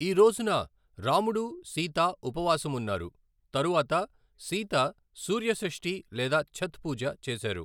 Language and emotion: Telugu, neutral